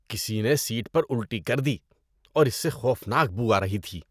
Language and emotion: Urdu, disgusted